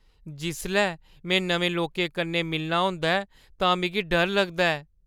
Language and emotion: Dogri, fearful